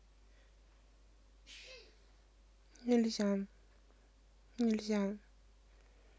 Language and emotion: Russian, neutral